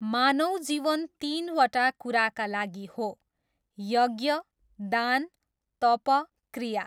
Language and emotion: Nepali, neutral